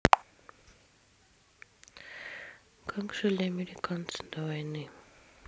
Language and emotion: Russian, neutral